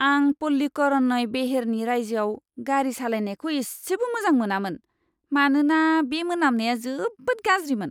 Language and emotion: Bodo, disgusted